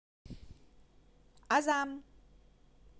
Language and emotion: Russian, positive